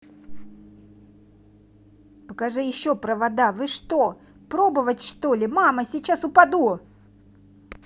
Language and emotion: Russian, angry